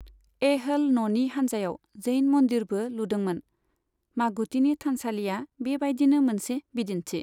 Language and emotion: Bodo, neutral